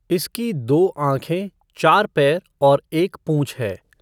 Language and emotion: Hindi, neutral